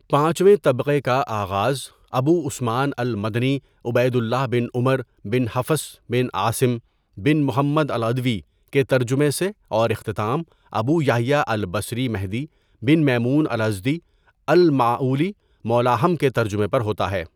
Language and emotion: Urdu, neutral